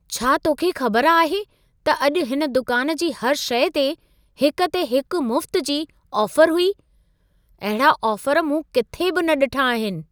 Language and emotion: Sindhi, surprised